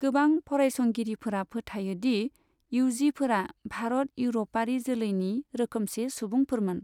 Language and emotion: Bodo, neutral